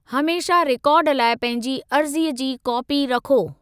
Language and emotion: Sindhi, neutral